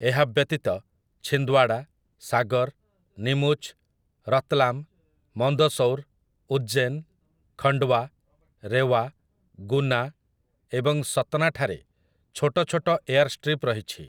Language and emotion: Odia, neutral